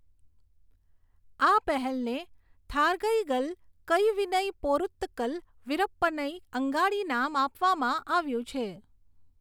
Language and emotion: Gujarati, neutral